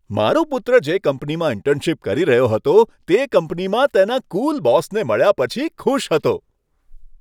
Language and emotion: Gujarati, happy